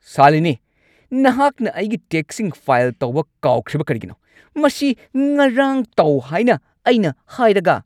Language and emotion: Manipuri, angry